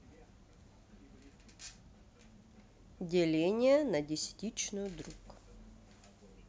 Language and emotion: Russian, neutral